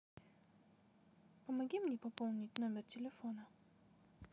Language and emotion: Russian, neutral